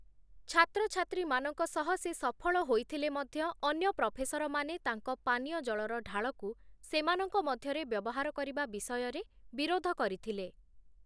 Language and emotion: Odia, neutral